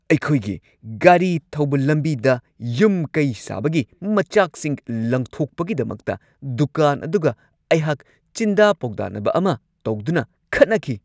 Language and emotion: Manipuri, angry